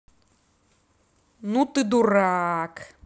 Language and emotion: Russian, angry